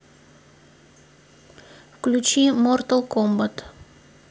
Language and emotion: Russian, neutral